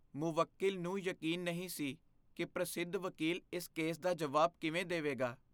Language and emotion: Punjabi, fearful